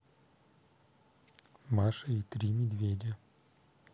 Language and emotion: Russian, neutral